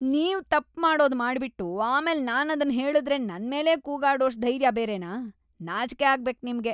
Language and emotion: Kannada, disgusted